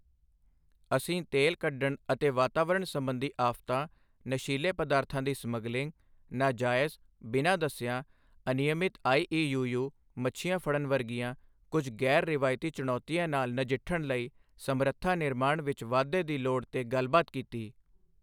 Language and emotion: Punjabi, neutral